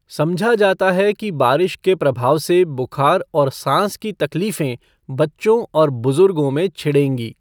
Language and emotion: Hindi, neutral